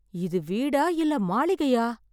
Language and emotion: Tamil, surprised